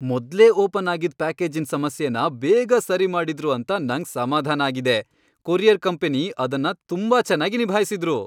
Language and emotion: Kannada, happy